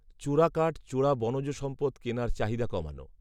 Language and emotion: Bengali, neutral